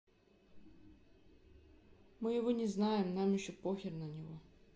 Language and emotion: Russian, neutral